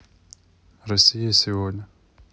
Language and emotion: Russian, neutral